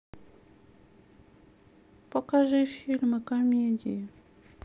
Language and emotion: Russian, sad